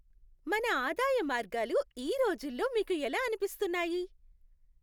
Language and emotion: Telugu, happy